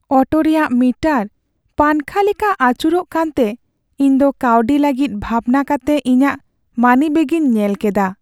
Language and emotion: Santali, sad